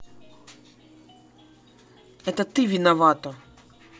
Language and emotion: Russian, angry